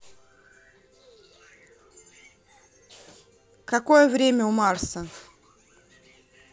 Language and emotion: Russian, neutral